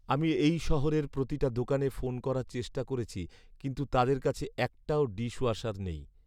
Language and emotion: Bengali, sad